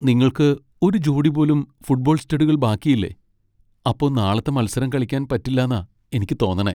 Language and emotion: Malayalam, sad